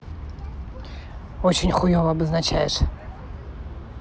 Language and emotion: Russian, neutral